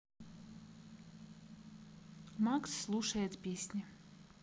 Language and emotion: Russian, neutral